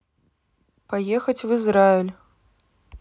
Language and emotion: Russian, neutral